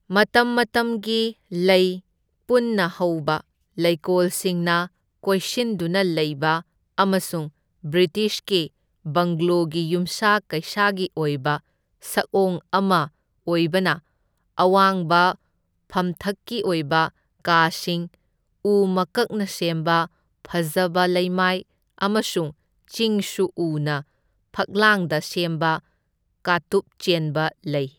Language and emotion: Manipuri, neutral